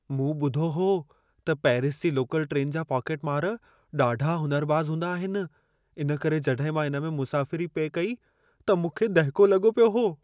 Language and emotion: Sindhi, fearful